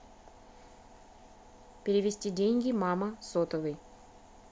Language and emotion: Russian, neutral